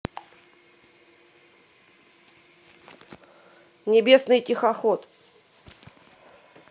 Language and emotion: Russian, neutral